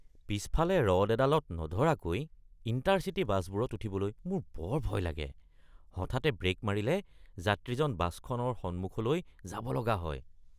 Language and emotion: Assamese, disgusted